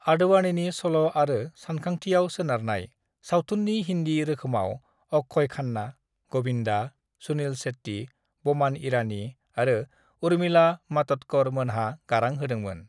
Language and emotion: Bodo, neutral